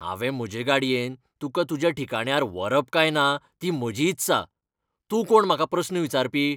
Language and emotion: Goan Konkani, angry